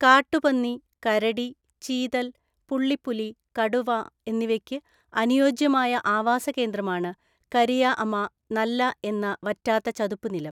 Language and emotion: Malayalam, neutral